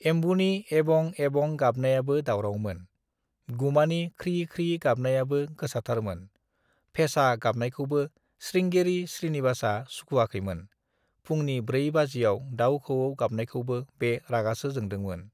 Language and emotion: Bodo, neutral